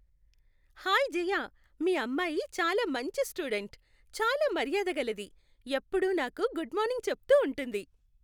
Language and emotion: Telugu, happy